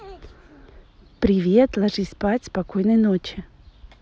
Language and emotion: Russian, positive